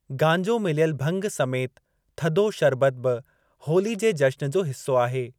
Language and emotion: Sindhi, neutral